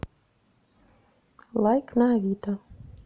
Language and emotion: Russian, neutral